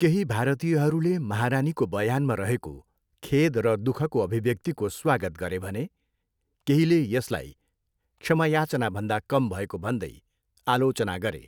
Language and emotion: Nepali, neutral